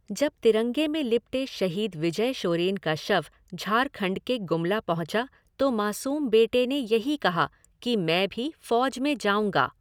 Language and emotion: Hindi, neutral